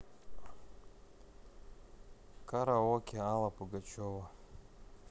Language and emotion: Russian, sad